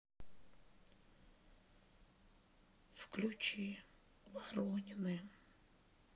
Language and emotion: Russian, sad